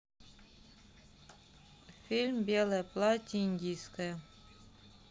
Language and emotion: Russian, neutral